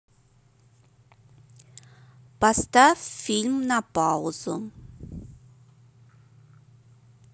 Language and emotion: Russian, neutral